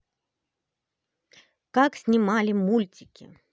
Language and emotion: Russian, positive